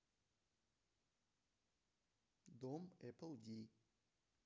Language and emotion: Russian, neutral